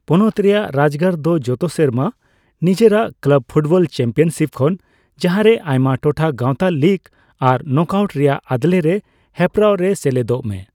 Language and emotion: Santali, neutral